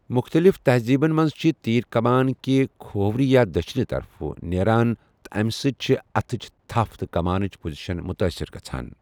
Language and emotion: Kashmiri, neutral